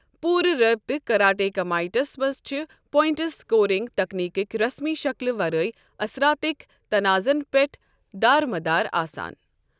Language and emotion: Kashmiri, neutral